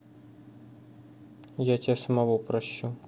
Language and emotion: Russian, neutral